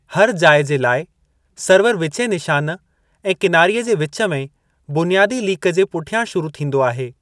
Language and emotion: Sindhi, neutral